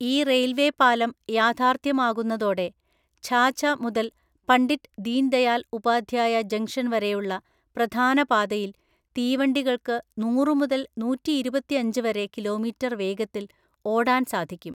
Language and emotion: Malayalam, neutral